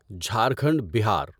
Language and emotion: Urdu, neutral